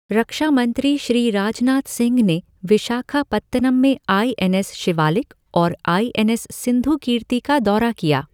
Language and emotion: Hindi, neutral